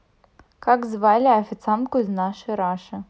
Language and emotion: Russian, neutral